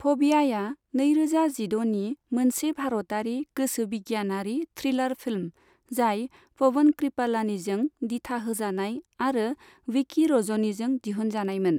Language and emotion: Bodo, neutral